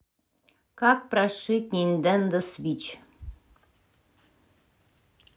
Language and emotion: Russian, neutral